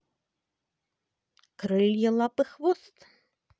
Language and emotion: Russian, positive